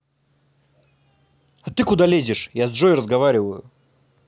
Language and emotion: Russian, angry